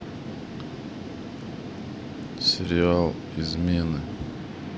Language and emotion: Russian, neutral